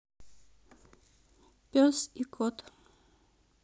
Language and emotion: Russian, neutral